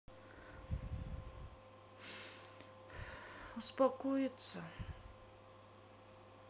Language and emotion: Russian, sad